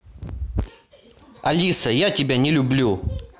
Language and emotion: Russian, angry